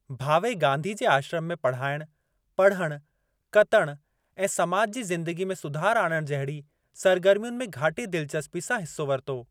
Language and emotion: Sindhi, neutral